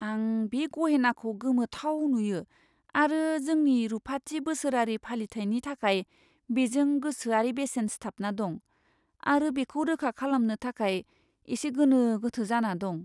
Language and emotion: Bodo, fearful